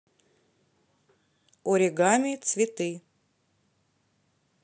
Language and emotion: Russian, neutral